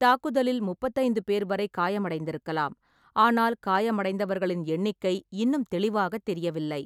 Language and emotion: Tamil, neutral